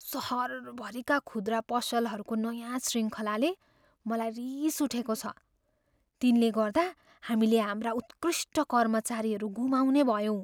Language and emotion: Nepali, fearful